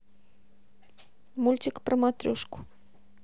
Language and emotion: Russian, neutral